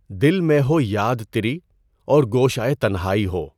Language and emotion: Urdu, neutral